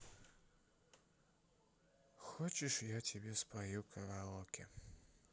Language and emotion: Russian, sad